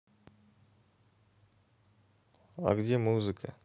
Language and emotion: Russian, neutral